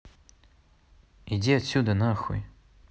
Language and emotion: Russian, angry